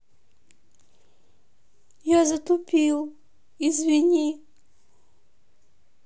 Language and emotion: Russian, sad